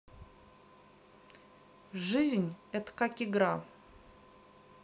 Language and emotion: Russian, neutral